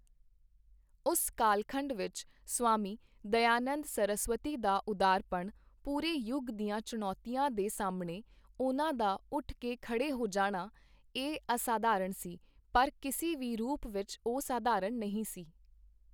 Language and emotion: Punjabi, neutral